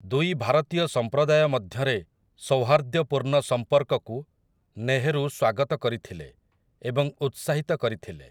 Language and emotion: Odia, neutral